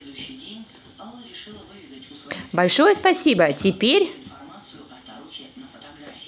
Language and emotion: Russian, positive